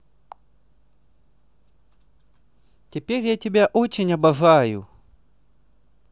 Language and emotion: Russian, positive